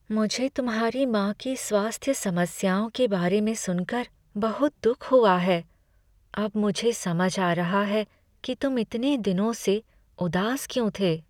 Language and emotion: Hindi, sad